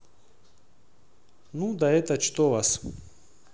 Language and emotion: Russian, neutral